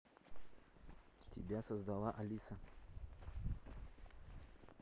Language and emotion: Russian, neutral